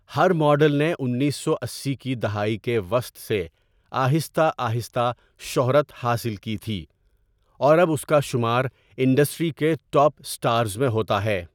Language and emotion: Urdu, neutral